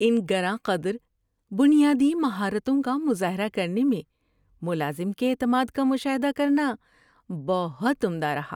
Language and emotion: Urdu, happy